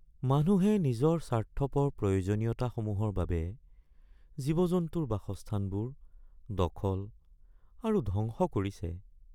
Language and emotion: Assamese, sad